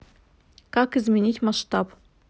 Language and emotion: Russian, neutral